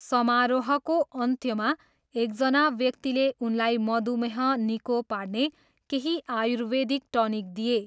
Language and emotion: Nepali, neutral